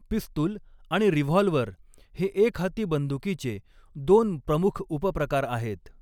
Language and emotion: Marathi, neutral